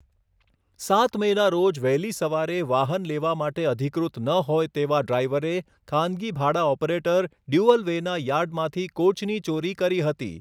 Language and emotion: Gujarati, neutral